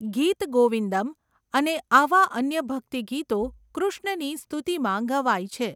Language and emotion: Gujarati, neutral